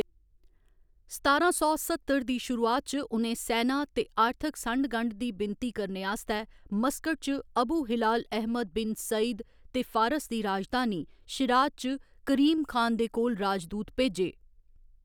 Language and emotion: Dogri, neutral